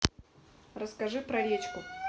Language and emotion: Russian, neutral